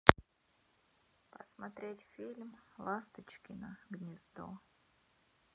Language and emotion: Russian, sad